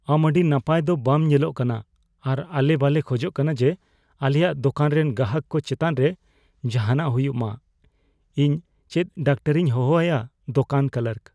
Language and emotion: Santali, fearful